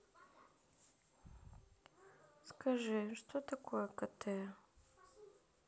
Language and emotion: Russian, sad